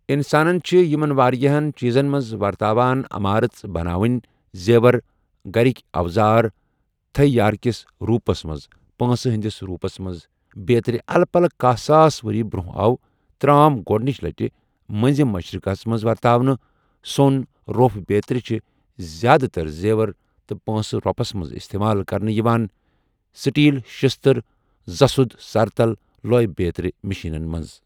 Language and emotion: Kashmiri, neutral